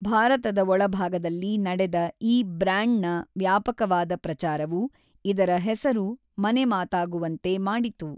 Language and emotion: Kannada, neutral